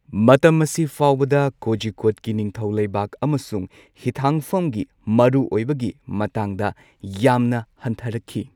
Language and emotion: Manipuri, neutral